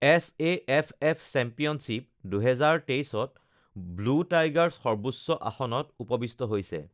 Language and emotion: Assamese, neutral